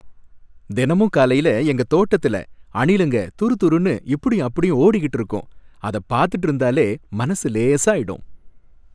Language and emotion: Tamil, happy